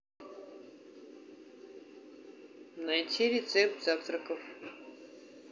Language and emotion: Russian, neutral